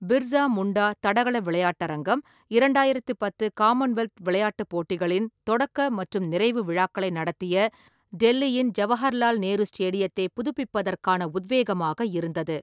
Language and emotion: Tamil, neutral